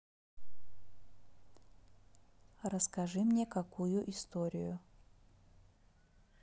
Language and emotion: Russian, neutral